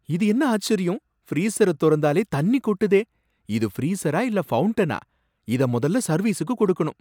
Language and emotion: Tamil, surprised